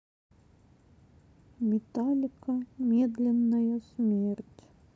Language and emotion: Russian, sad